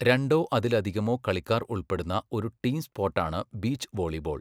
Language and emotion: Malayalam, neutral